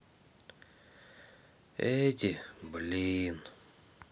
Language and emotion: Russian, sad